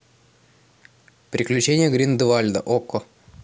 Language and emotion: Russian, neutral